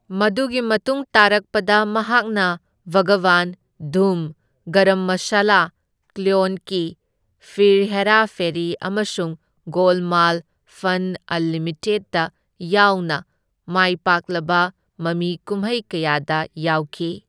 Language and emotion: Manipuri, neutral